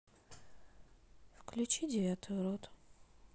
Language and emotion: Russian, neutral